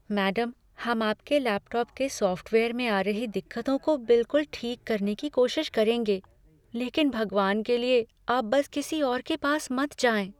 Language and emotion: Hindi, fearful